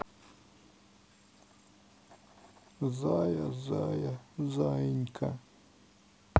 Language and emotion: Russian, sad